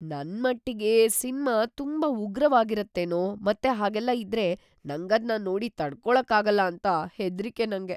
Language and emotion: Kannada, fearful